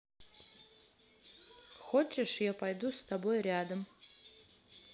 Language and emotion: Russian, neutral